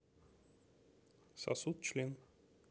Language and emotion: Russian, neutral